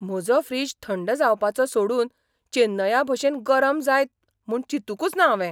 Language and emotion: Goan Konkani, surprised